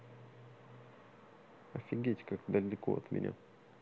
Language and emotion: Russian, neutral